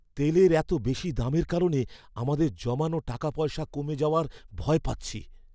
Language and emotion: Bengali, fearful